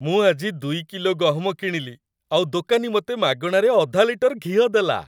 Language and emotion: Odia, happy